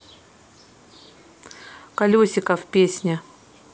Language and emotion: Russian, neutral